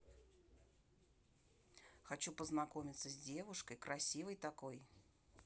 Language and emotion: Russian, neutral